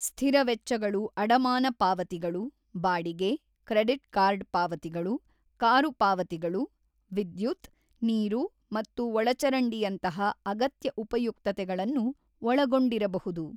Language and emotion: Kannada, neutral